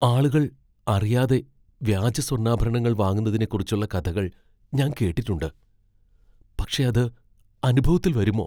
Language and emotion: Malayalam, fearful